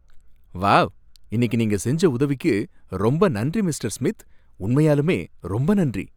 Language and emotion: Tamil, happy